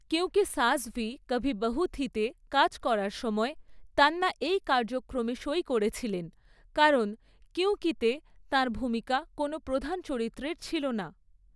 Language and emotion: Bengali, neutral